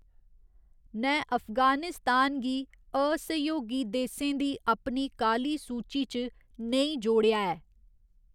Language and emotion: Dogri, neutral